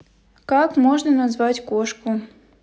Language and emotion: Russian, neutral